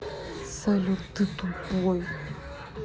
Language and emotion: Russian, angry